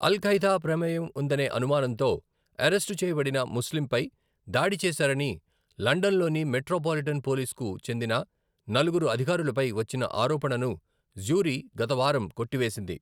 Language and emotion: Telugu, neutral